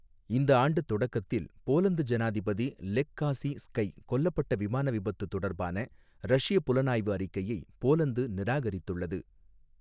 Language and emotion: Tamil, neutral